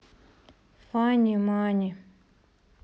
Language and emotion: Russian, sad